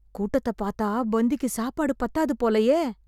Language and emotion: Tamil, fearful